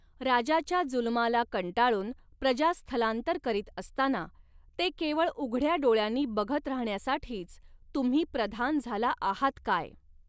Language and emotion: Marathi, neutral